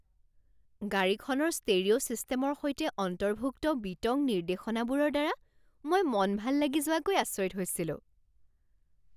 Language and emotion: Assamese, surprised